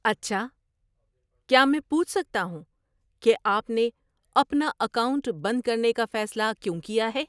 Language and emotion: Urdu, surprised